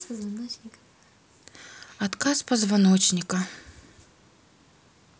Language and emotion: Russian, sad